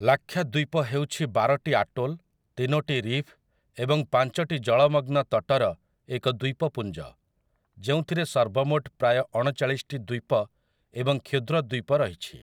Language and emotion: Odia, neutral